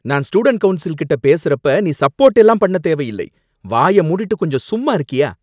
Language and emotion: Tamil, angry